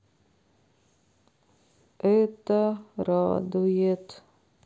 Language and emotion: Russian, sad